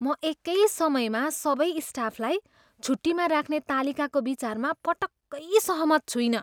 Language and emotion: Nepali, disgusted